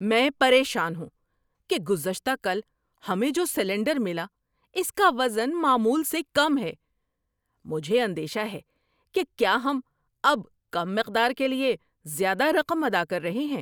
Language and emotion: Urdu, angry